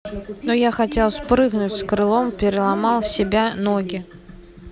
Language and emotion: Russian, neutral